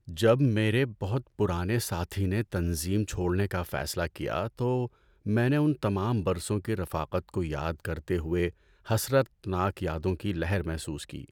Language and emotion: Urdu, sad